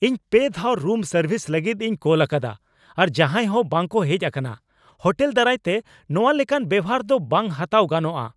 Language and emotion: Santali, angry